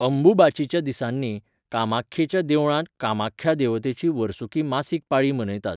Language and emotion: Goan Konkani, neutral